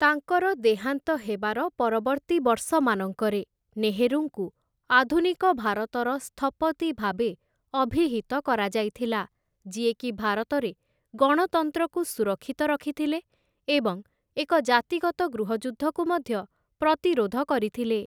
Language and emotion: Odia, neutral